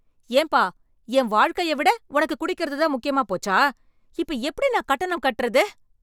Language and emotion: Tamil, angry